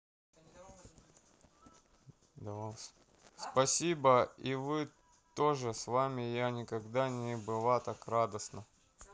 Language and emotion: Russian, neutral